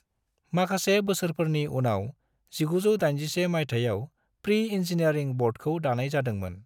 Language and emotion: Bodo, neutral